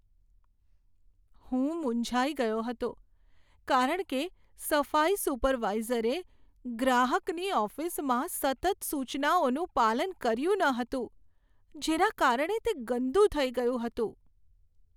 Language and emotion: Gujarati, sad